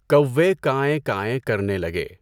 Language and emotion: Urdu, neutral